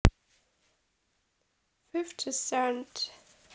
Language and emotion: Russian, neutral